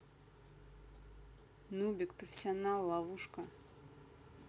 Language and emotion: Russian, neutral